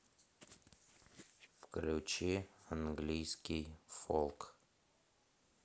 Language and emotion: Russian, neutral